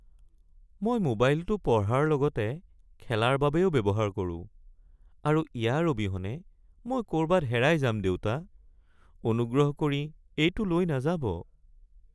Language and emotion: Assamese, sad